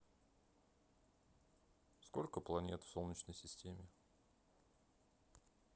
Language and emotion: Russian, neutral